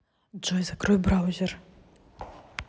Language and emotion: Russian, neutral